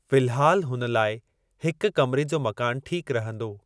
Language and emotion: Sindhi, neutral